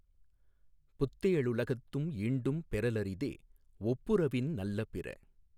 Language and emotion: Tamil, neutral